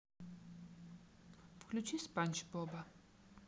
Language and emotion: Russian, neutral